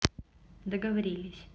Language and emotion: Russian, neutral